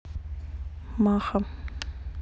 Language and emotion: Russian, neutral